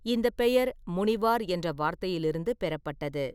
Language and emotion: Tamil, neutral